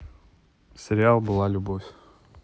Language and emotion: Russian, neutral